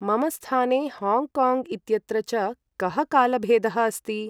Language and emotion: Sanskrit, neutral